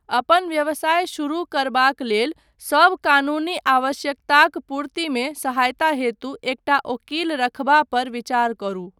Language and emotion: Maithili, neutral